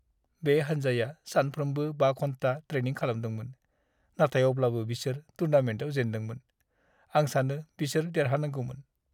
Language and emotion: Bodo, sad